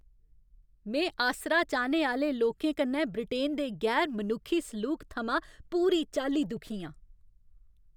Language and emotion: Dogri, angry